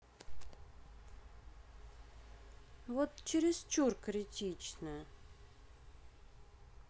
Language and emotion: Russian, neutral